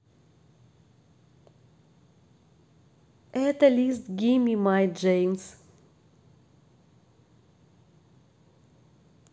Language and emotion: Russian, neutral